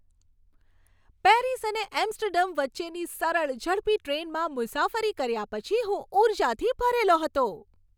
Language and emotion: Gujarati, happy